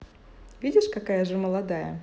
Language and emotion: Russian, positive